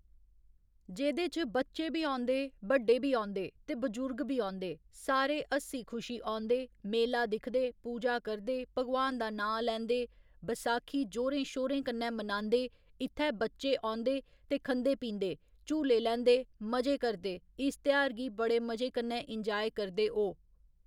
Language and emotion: Dogri, neutral